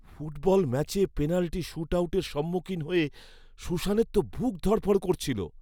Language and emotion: Bengali, fearful